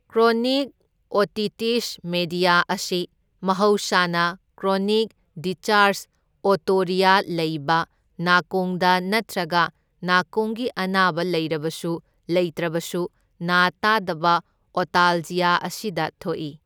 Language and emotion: Manipuri, neutral